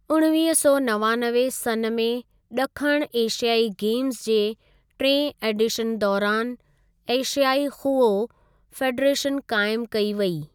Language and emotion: Sindhi, neutral